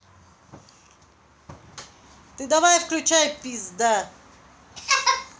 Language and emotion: Russian, angry